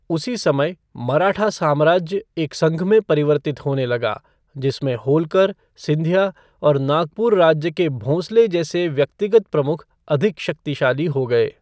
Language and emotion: Hindi, neutral